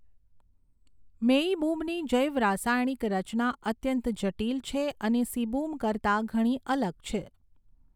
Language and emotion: Gujarati, neutral